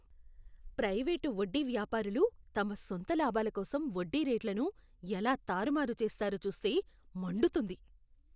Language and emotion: Telugu, disgusted